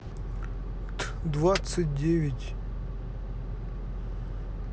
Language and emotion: Russian, neutral